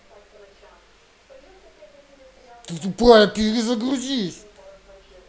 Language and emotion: Russian, angry